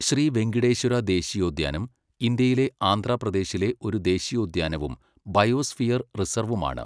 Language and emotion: Malayalam, neutral